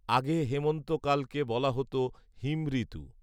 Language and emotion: Bengali, neutral